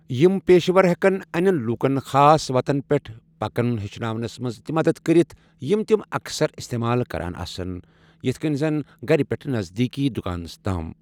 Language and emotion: Kashmiri, neutral